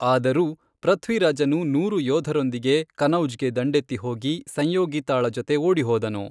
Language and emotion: Kannada, neutral